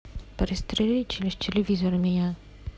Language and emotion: Russian, sad